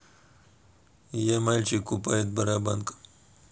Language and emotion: Russian, neutral